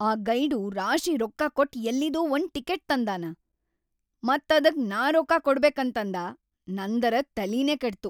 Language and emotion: Kannada, angry